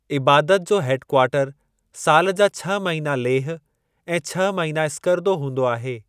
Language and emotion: Sindhi, neutral